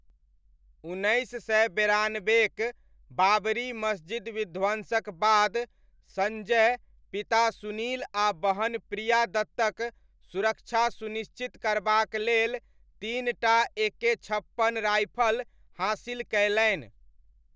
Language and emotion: Maithili, neutral